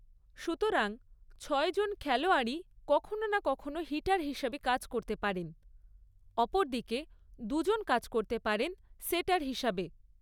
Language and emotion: Bengali, neutral